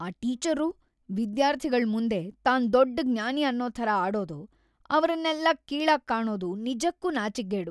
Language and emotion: Kannada, disgusted